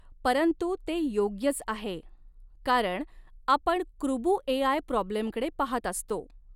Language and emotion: Marathi, neutral